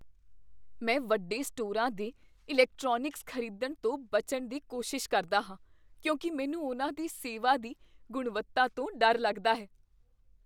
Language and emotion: Punjabi, fearful